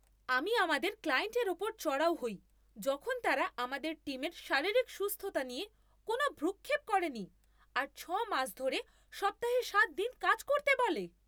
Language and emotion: Bengali, angry